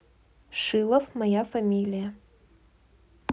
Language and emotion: Russian, neutral